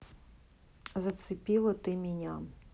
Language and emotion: Russian, neutral